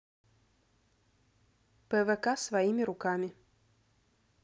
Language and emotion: Russian, neutral